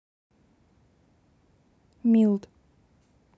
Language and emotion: Russian, neutral